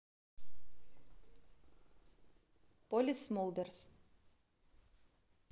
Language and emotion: Russian, neutral